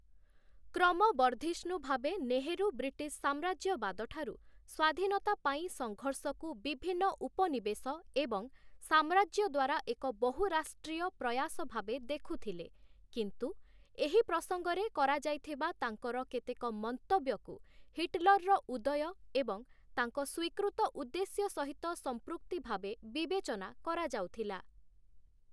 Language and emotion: Odia, neutral